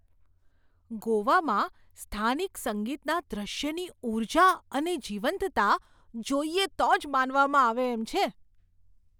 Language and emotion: Gujarati, surprised